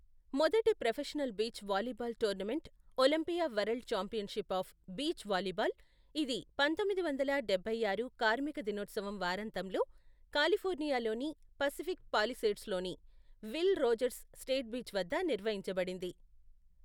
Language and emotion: Telugu, neutral